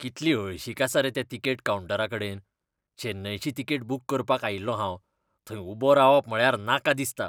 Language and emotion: Goan Konkani, disgusted